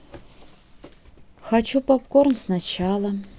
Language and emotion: Russian, neutral